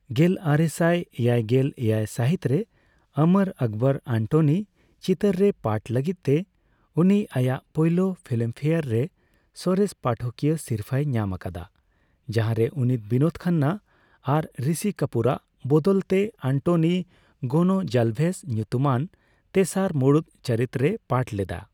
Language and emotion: Santali, neutral